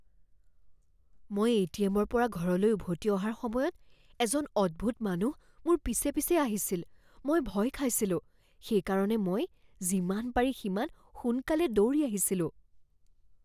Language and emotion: Assamese, fearful